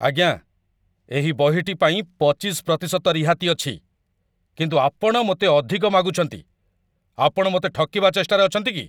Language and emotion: Odia, angry